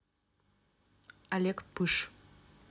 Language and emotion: Russian, neutral